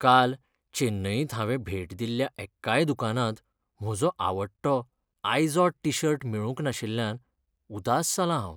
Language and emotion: Goan Konkani, sad